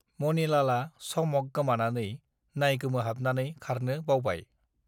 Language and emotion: Bodo, neutral